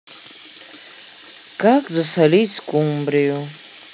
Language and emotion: Russian, sad